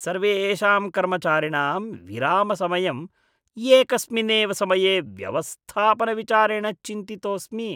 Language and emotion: Sanskrit, disgusted